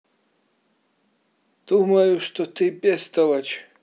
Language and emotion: Russian, neutral